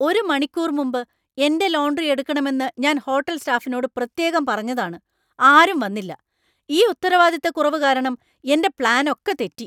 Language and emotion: Malayalam, angry